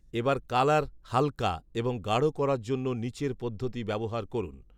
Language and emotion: Bengali, neutral